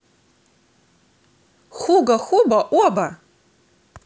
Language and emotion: Russian, positive